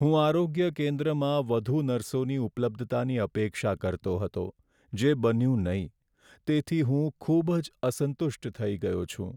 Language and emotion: Gujarati, sad